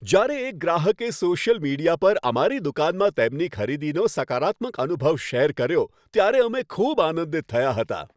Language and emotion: Gujarati, happy